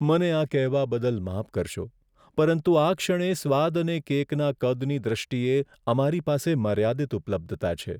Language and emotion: Gujarati, sad